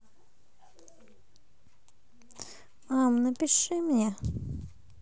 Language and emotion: Russian, sad